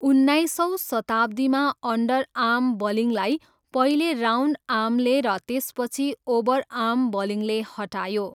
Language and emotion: Nepali, neutral